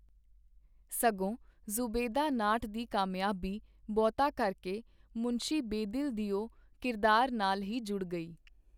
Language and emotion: Punjabi, neutral